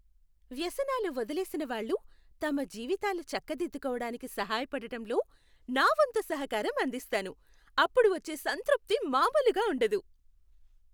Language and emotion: Telugu, happy